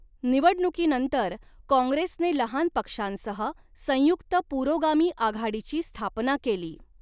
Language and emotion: Marathi, neutral